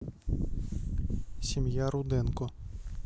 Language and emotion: Russian, neutral